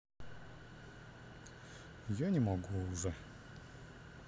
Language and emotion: Russian, sad